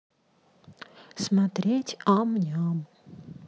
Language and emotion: Russian, neutral